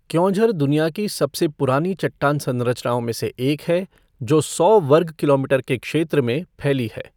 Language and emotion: Hindi, neutral